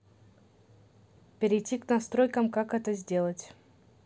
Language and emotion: Russian, neutral